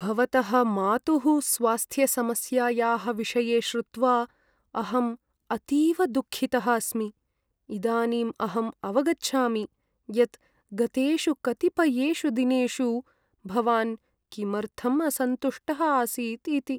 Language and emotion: Sanskrit, sad